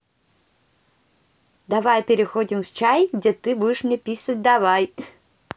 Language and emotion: Russian, positive